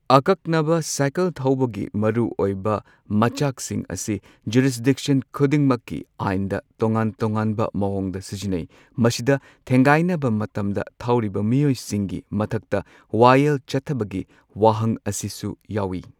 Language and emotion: Manipuri, neutral